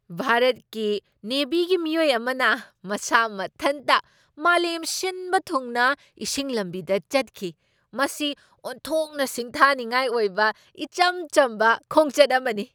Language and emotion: Manipuri, surprised